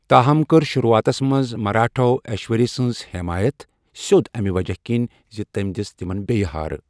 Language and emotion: Kashmiri, neutral